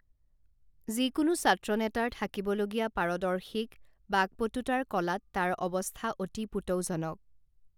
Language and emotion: Assamese, neutral